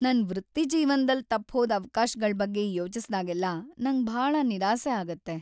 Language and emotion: Kannada, sad